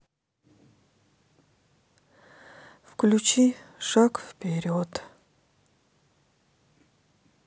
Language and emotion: Russian, sad